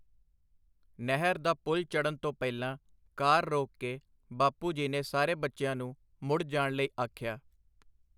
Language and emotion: Punjabi, neutral